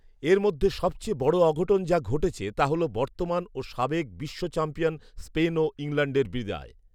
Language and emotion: Bengali, neutral